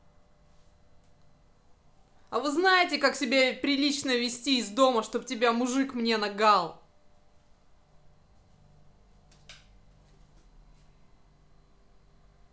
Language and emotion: Russian, angry